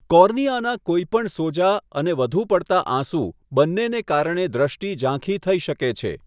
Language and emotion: Gujarati, neutral